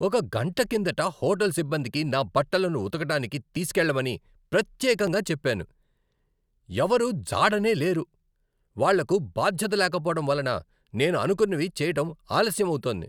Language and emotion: Telugu, angry